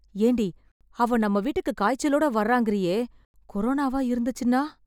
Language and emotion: Tamil, fearful